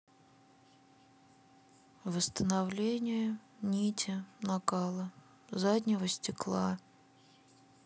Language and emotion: Russian, sad